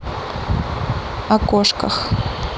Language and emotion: Russian, neutral